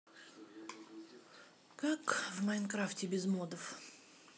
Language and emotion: Russian, neutral